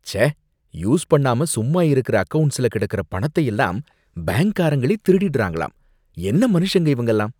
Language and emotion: Tamil, disgusted